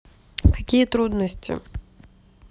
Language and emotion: Russian, neutral